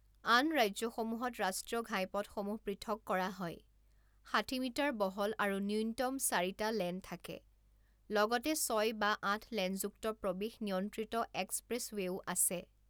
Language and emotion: Assamese, neutral